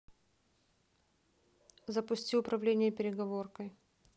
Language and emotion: Russian, neutral